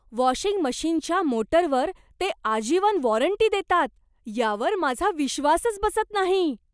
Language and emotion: Marathi, surprised